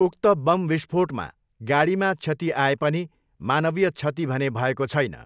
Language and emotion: Nepali, neutral